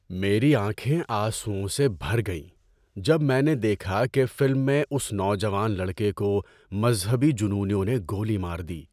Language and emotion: Urdu, sad